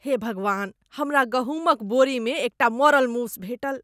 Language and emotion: Maithili, disgusted